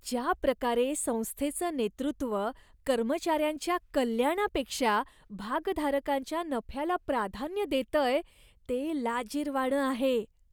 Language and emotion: Marathi, disgusted